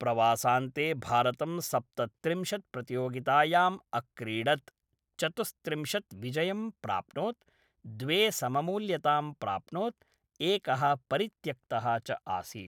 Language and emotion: Sanskrit, neutral